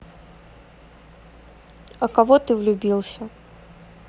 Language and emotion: Russian, neutral